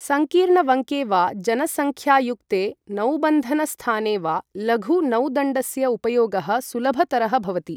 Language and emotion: Sanskrit, neutral